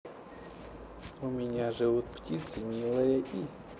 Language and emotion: Russian, neutral